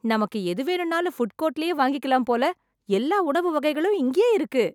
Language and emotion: Tamil, happy